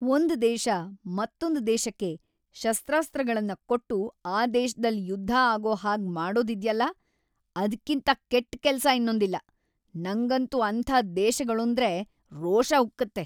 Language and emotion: Kannada, angry